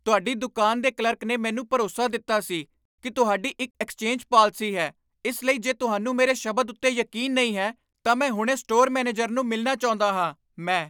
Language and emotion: Punjabi, angry